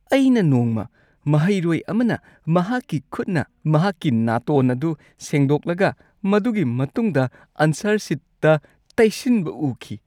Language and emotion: Manipuri, disgusted